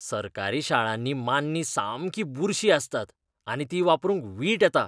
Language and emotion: Goan Konkani, disgusted